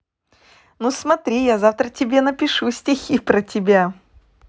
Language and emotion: Russian, positive